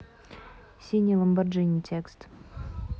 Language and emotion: Russian, neutral